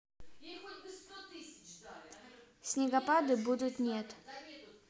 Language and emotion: Russian, neutral